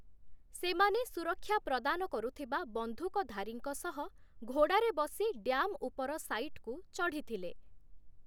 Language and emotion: Odia, neutral